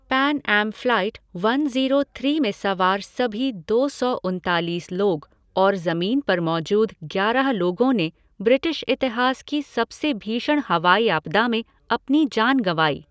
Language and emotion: Hindi, neutral